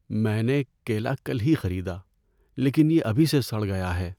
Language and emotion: Urdu, sad